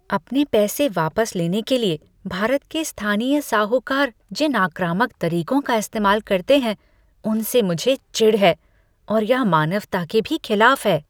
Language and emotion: Hindi, disgusted